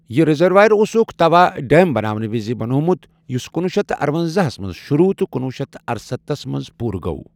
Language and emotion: Kashmiri, neutral